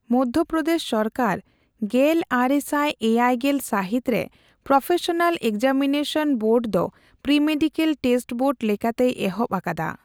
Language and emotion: Santali, neutral